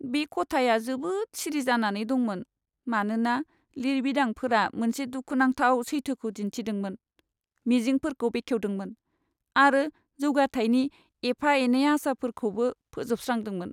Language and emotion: Bodo, sad